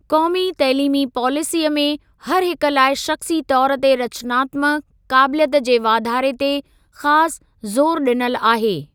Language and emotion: Sindhi, neutral